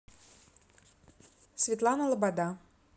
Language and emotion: Russian, neutral